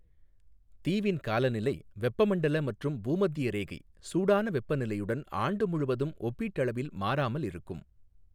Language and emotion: Tamil, neutral